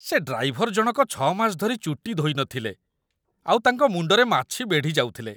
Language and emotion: Odia, disgusted